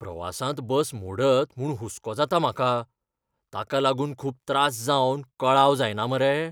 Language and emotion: Goan Konkani, fearful